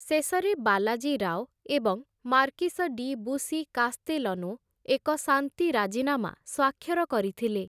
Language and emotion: Odia, neutral